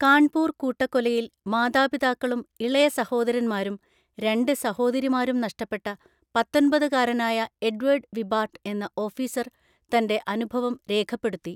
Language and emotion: Malayalam, neutral